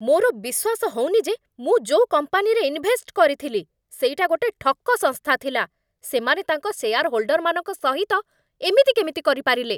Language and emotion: Odia, angry